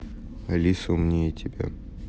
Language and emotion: Russian, neutral